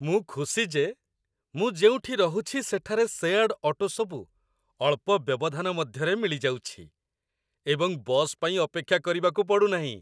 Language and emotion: Odia, happy